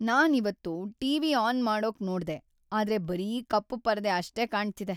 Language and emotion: Kannada, sad